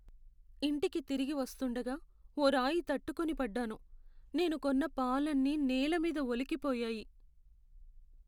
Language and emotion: Telugu, sad